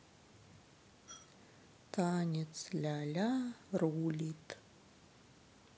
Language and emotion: Russian, sad